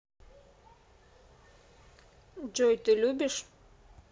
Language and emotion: Russian, neutral